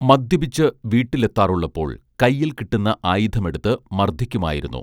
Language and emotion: Malayalam, neutral